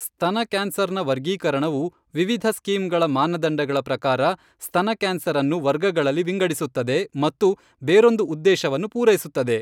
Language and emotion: Kannada, neutral